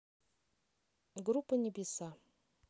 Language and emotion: Russian, neutral